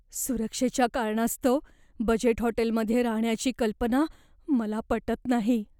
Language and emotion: Marathi, fearful